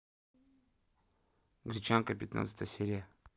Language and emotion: Russian, neutral